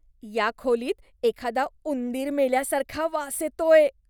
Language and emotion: Marathi, disgusted